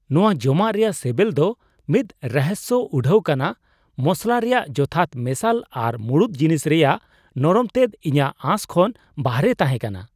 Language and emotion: Santali, surprised